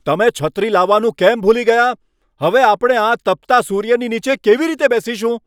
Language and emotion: Gujarati, angry